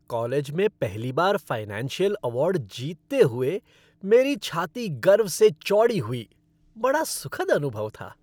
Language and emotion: Hindi, happy